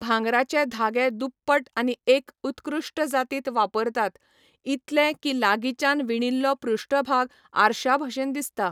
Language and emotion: Goan Konkani, neutral